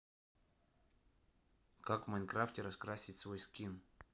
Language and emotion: Russian, neutral